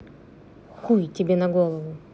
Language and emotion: Russian, angry